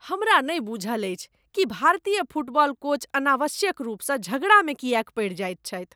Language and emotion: Maithili, disgusted